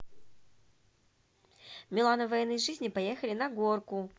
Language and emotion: Russian, positive